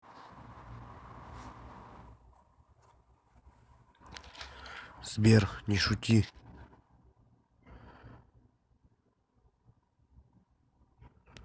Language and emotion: Russian, neutral